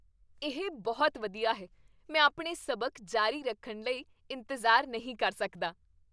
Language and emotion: Punjabi, happy